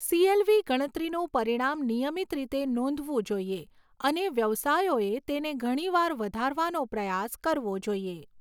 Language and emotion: Gujarati, neutral